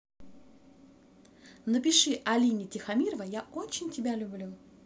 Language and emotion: Russian, positive